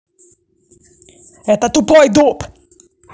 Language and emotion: Russian, angry